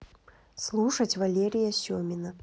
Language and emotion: Russian, neutral